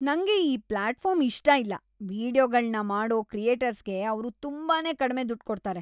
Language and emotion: Kannada, disgusted